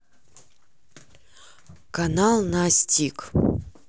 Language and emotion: Russian, neutral